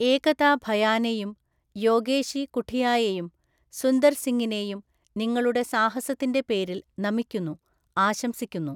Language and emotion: Malayalam, neutral